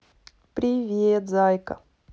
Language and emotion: Russian, positive